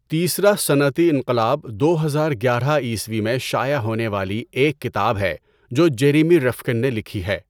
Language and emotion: Urdu, neutral